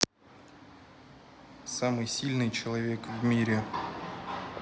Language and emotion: Russian, neutral